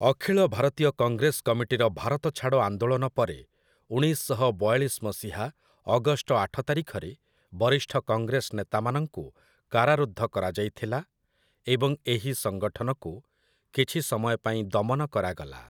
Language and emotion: Odia, neutral